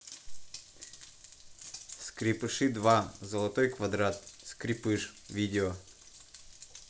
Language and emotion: Russian, neutral